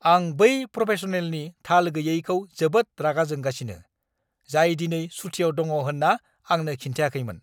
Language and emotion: Bodo, angry